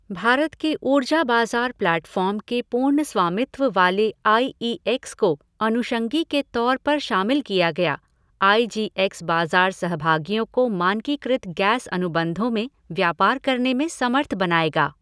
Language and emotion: Hindi, neutral